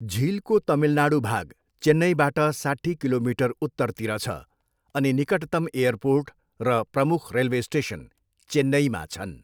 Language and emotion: Nepali, neutral